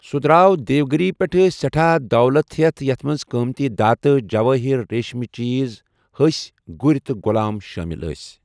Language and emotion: Kashmiri, neutral